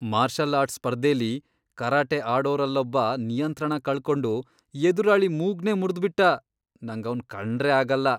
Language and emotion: Kannada, disgusted